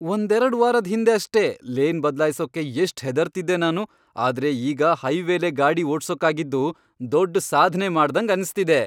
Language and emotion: Kannada, happy